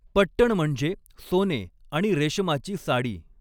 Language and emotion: Marathi, neutral